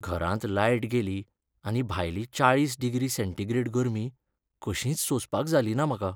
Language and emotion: Goan Konkani, sad